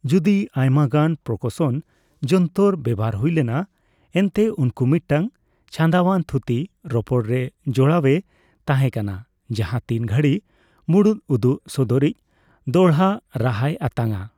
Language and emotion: Santali, neutral